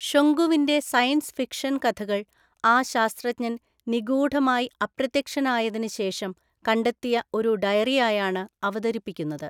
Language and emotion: Malayalam, neutral